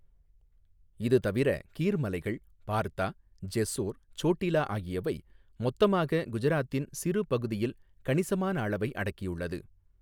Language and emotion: Tamil, neutral